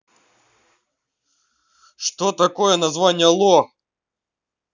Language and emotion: Russian, angry